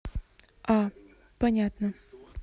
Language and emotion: Russian, neutral